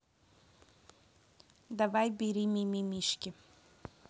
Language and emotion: Russian, neutral